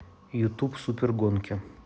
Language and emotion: Russian, neutral